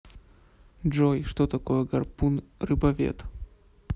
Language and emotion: Russian, neutral